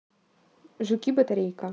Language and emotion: Russian, neutral